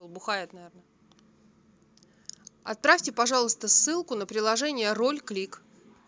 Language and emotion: Russian, neutral